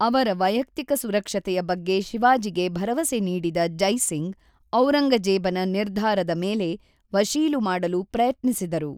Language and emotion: Kannada, neutral